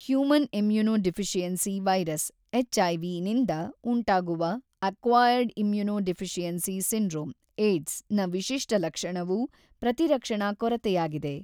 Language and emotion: Kannada, neutral